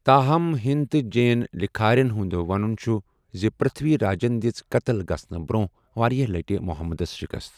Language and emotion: Kashmiri, neutral